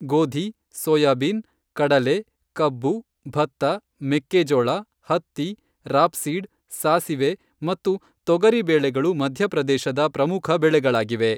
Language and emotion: Kannada, neutral